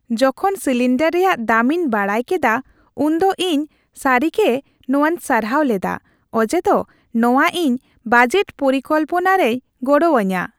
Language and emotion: Santali, happy